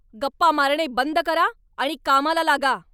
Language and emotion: Marathi, angry